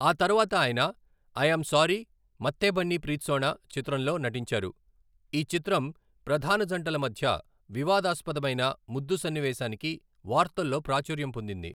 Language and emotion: Telugu, neutral